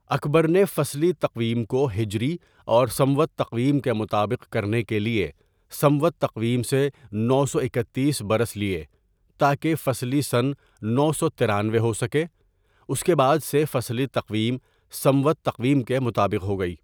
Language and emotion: Urdu, neutral